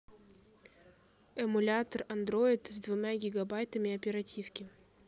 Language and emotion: Russian, neutral